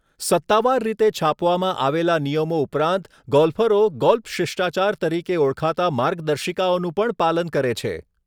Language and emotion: Gujarati, neutral